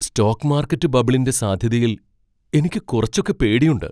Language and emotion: Malayalam, fearful